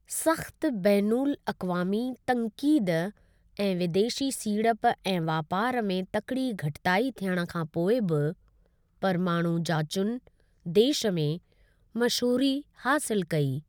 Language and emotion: Sindhi, neutral